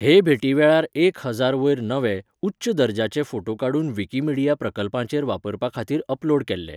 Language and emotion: Goan Konkani, neutral